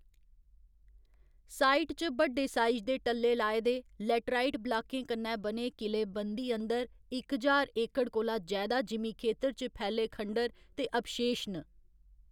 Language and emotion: Dogri, neutral